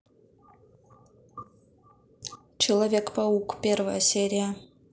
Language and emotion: Russian, neutral